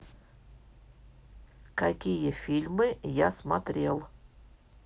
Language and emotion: Russian, neutral